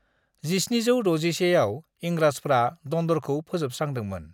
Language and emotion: Bodo, neutral